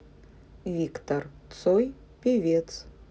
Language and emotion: Russian, neutral